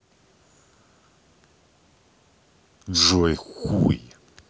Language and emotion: Russian, angry